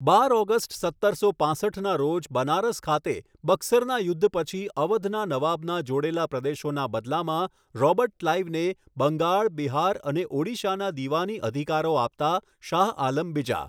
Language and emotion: Gujarati, neutral